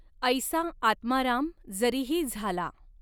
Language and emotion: Marathi, neutral